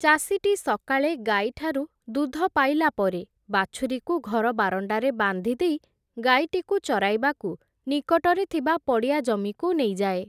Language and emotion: Odia, neutral